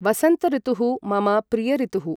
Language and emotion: Sanskrit, neutral